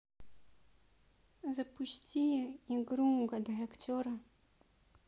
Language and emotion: Russian, sad